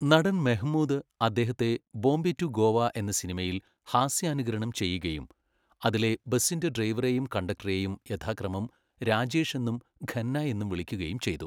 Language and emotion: Malayalam, neutral